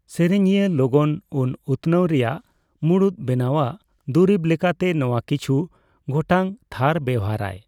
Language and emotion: Santali, neutral